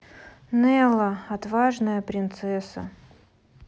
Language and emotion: Russian, sad